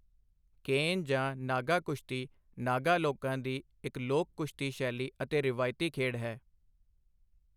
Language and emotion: Punjabi, neutral